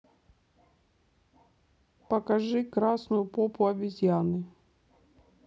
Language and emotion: Russian, neutral